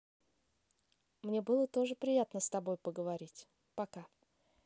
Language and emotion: Russian, positive